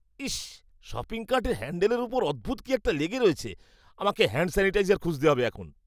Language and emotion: Bengali, disgusted